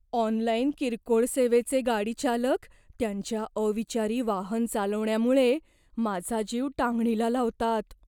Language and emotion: Marathi, fearful